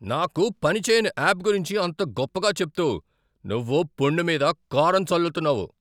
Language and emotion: Telugu, angry